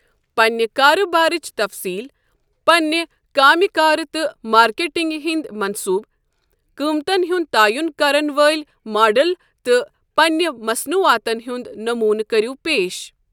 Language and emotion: Kashmiri, neutral